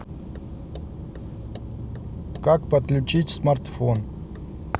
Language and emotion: Russian, neutral